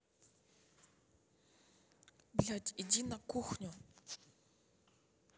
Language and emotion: Russian, angry